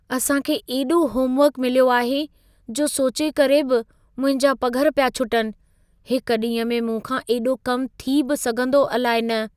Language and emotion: Sindhi, fearful